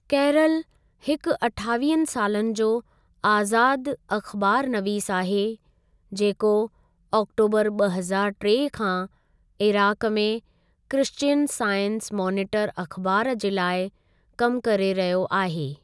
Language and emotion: Sindhi, neutral